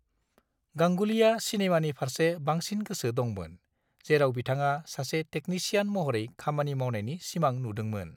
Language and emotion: Bodo, neutral